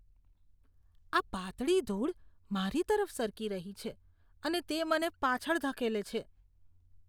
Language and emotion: Gujarati, disgusted